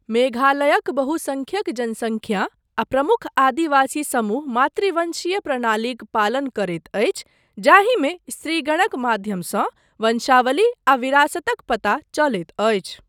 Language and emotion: Maithili, neutral